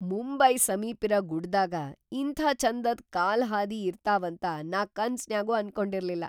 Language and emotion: Kannada, surprised